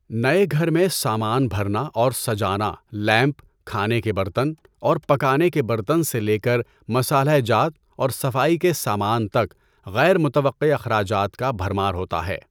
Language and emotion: Urdu, neutral